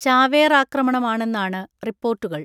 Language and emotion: Malayalam, neutral